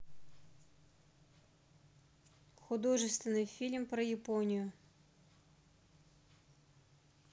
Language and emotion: Russian, neutral